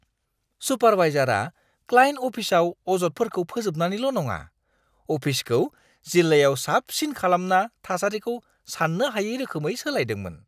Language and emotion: Bodo, surprised